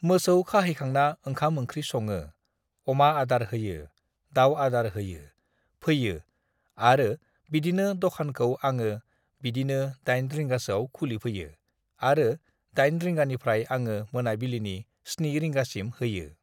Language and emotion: Bodo, neutral